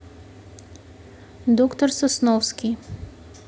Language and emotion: Russian, neutral